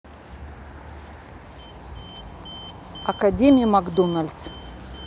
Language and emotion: Russian, neutral